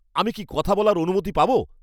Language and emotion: Bengali, angry